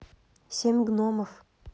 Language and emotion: Russian, neutral